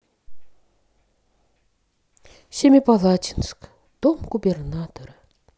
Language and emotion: Russian, sad